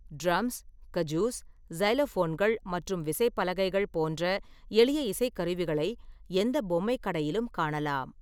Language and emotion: Tamil, neutral